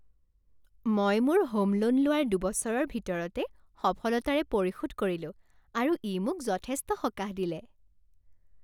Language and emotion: Assamese, happy